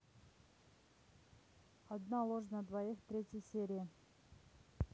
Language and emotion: Russian, neutral